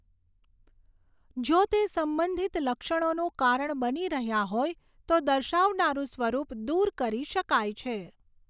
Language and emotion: Gujarati, neutral